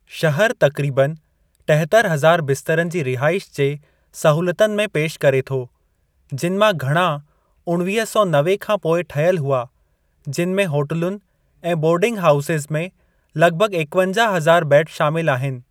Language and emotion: Sindhi, neutral